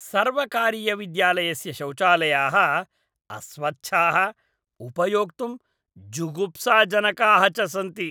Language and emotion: Sanskrit, disgusted